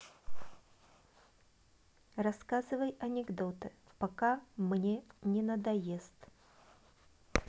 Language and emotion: Russian, neutral